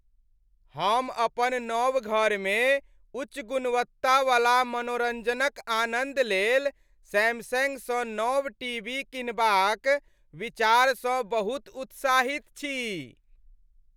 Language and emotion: Maithili, happy